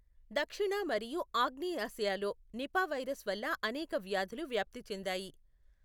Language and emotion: Telugu, neutral